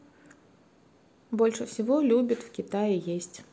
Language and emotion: Russian, neutral